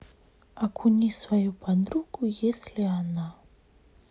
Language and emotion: Russian, sad